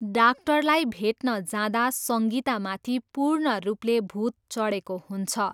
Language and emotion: Nepali, neutral